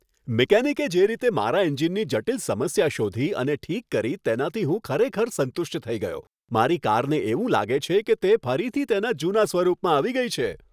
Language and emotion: Gujarati, happy